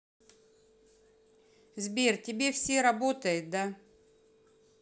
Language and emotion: Russian, neutral